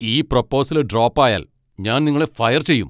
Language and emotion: Malayalam, angry